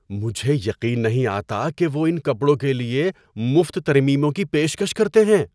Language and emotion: Urdu, surprised